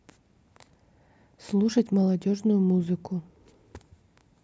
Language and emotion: Russian, neutral